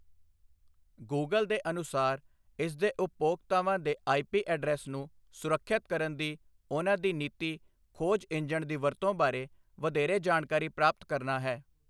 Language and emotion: Punjabi, neutral